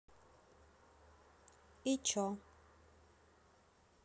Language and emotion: Russian, neutral